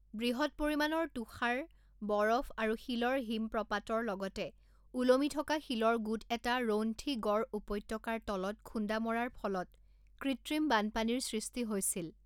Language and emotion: Assamese, neutral